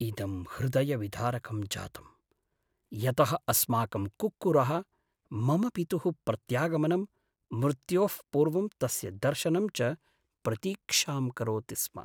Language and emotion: Sanskrit, sad